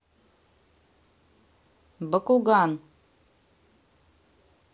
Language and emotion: Russian, neutral